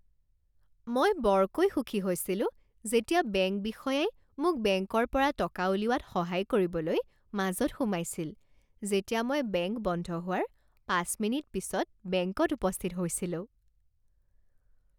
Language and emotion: Assamese, happy